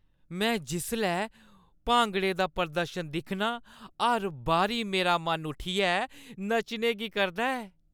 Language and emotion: Dogri, happy